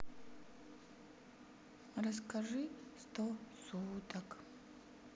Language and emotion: Russian, sad